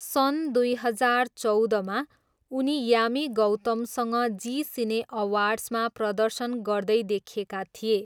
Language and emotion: Nepali, neutral